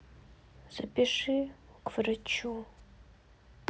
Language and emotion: Russian, sad